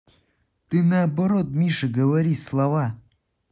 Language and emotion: Russian, neutral